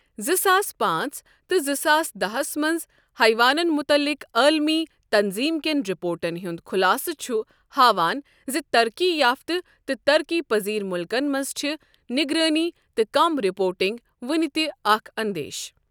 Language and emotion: Kashmiri, neutral